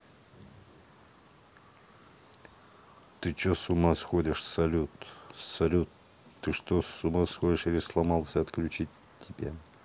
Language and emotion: Russian, neutral